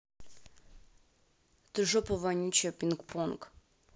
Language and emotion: Russian, angry